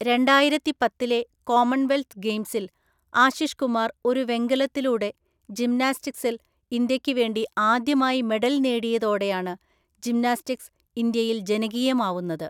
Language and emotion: Malayalam, neutral